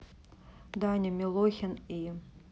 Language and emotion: Russian, neutral